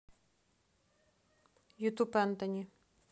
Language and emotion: Russian, neutral